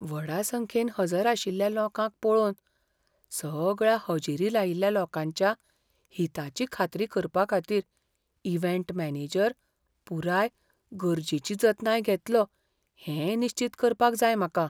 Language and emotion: Goan Konkani, fearful